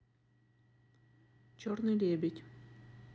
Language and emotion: Russian, neutral